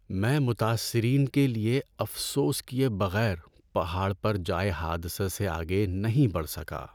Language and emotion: Urdu, sad